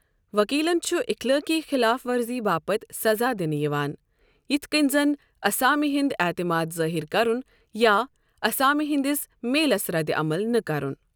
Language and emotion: Kashmiri, neutral